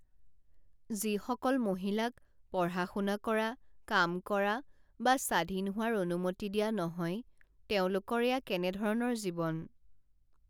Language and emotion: Assamese, sad